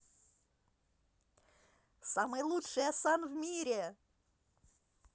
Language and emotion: Russian, positive